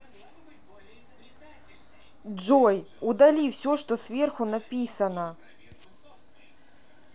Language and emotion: Russian, angry